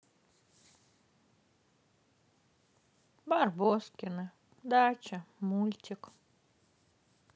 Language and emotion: Russian, sad